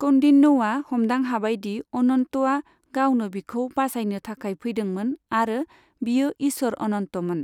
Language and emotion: Bodo, neutral